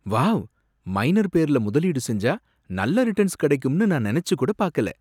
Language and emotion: Tamil, surprised